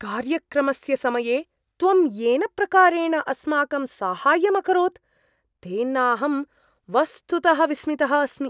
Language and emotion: Sanskrit, surprised